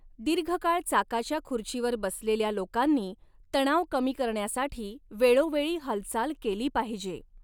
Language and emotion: Marathi, neutral